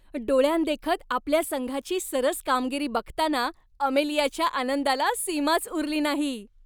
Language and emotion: Marathi, happy